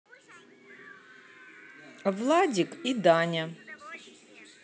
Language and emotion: Russian, neutral